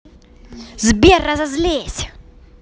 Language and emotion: Russian, angry